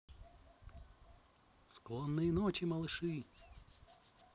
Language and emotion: Russian, positive